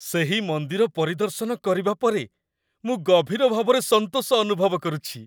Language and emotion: Odia, happy